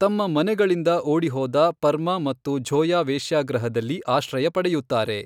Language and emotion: Kannada, neutral